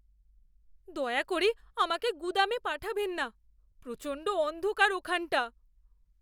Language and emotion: Bengali, fearful